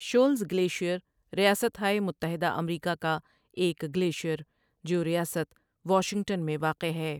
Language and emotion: Urdu, neutral